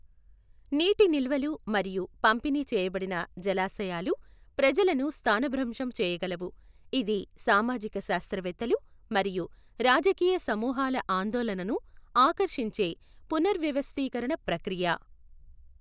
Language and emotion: Telugu, neutral